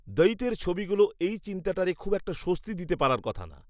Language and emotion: Bengali, neutral